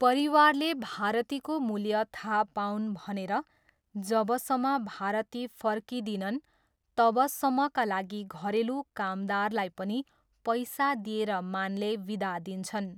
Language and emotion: Nepali, neutral